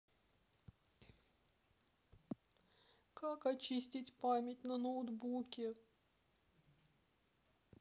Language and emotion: Russian, sad